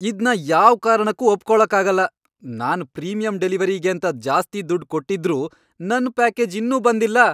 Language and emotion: Kannada, angry